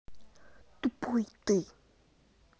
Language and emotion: Russian, angry